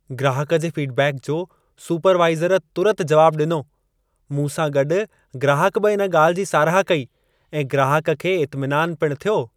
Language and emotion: Sindhi, happy